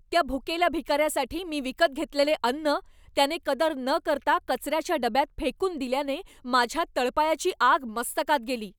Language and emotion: Marathi, angry